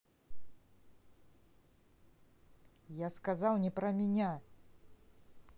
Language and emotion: Russian, angry